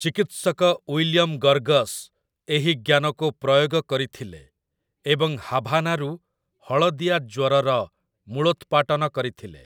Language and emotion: Odia, neutral